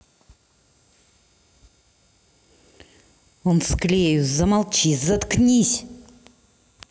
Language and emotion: Russian, angry